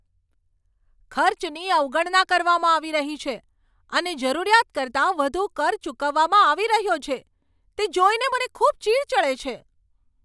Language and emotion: Gujarati, angry